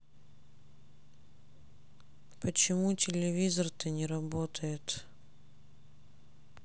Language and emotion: Russian, sad